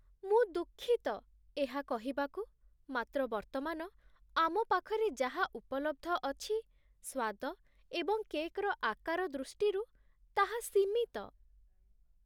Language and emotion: Odia, sad